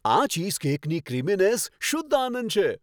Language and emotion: Gujarati, happy